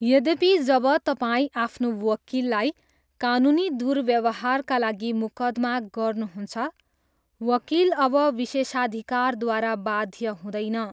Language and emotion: Nepali, neutral